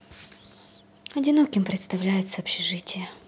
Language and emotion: Russian, sad